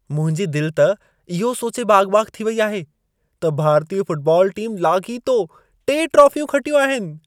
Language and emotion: Sindhi, happy